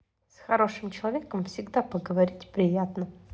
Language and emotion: Russian, positive